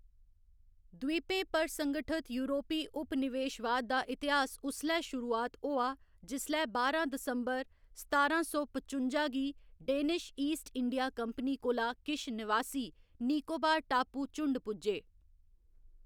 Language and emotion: Dogri, neutral